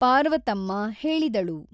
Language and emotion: Kannada, neutral